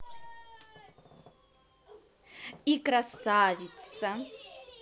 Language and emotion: Russian, positive